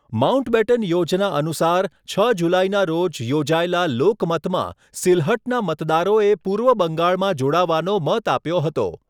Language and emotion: Gujarati, neutral